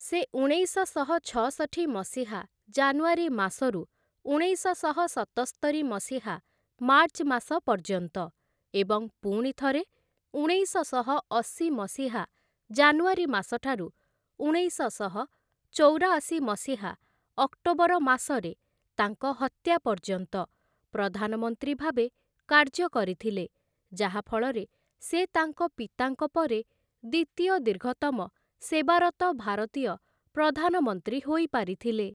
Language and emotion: Odia, neutral